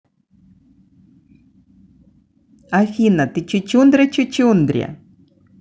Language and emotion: Russian, positive